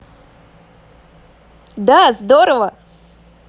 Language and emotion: Russian, positive